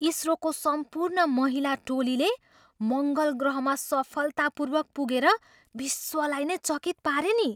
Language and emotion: Nepali, surprised